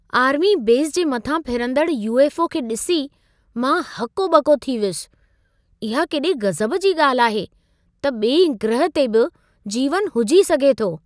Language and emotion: Sindhi, surprised